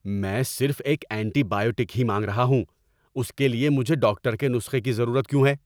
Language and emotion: Urdu, angry